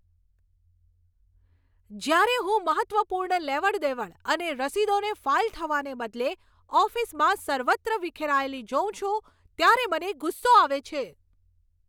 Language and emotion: Gujarati, angry